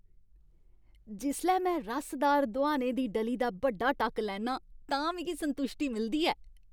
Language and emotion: Dogri, happy